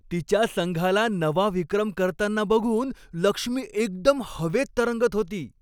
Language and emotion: Marathi, happy